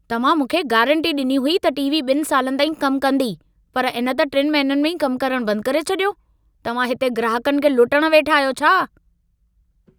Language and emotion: Sindhi, angry